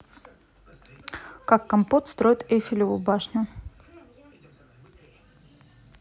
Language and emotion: Russian, neutral